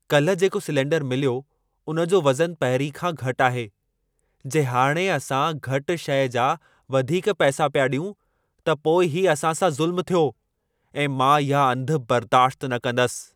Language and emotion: Sindhi, angry